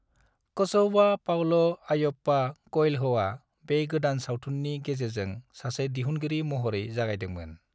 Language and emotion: Bodo, neutral